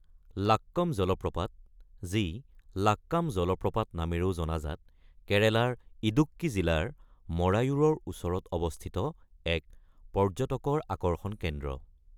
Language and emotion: Assamese, neutral